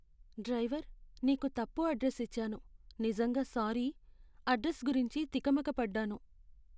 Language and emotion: Telugu, sad